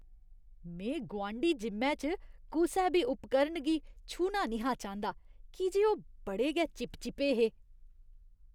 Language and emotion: Dogri, disgusted